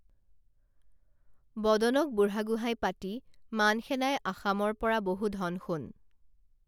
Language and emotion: Assamese, neutral